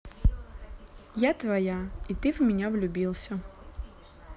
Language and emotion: Russian, positive